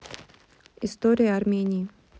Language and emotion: Russian, neutral